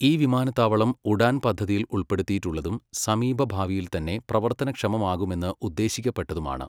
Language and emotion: Malayalam, neutral